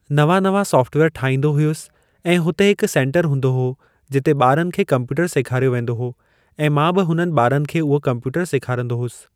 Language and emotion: Sindhi, neutral